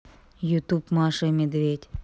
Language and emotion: Russian, neutral